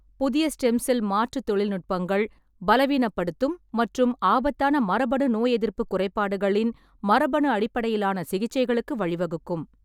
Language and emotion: Tamil, neutral